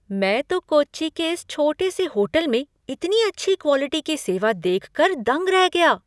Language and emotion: Hindi, surprised